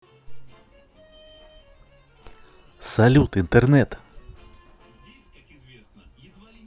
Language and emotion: Russian, positive